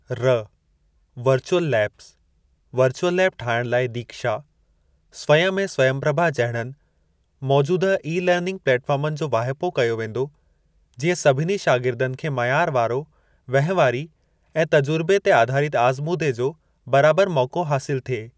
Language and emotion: Sindhi, neutral